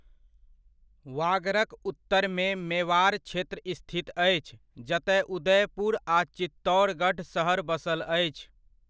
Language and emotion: Maithili, neutral